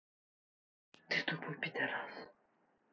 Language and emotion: Russian, angry